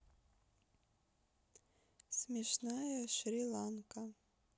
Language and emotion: Russian, neutral